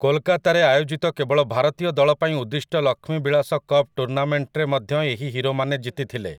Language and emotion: Odia, neutral